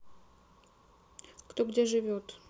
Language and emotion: Russian, neutral